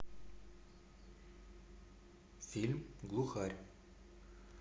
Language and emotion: Russian, neutral